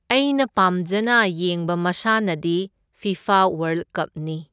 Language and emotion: Manipuri, neutral